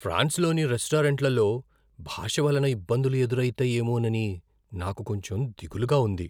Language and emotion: Telugu, fearful